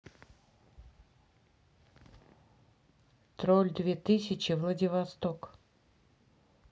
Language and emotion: Russian, neutral